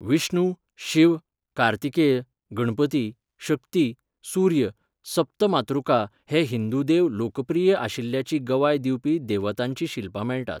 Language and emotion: Goan Konkani, neutral